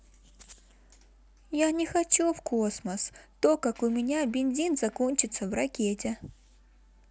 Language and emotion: Russian, sad